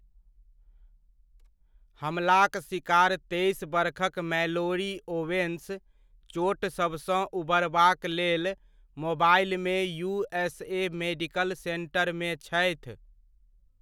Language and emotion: Maithili, neutral